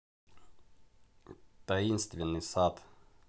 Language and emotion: Russian, neutral